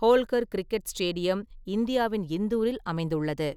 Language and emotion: Tamil, neutral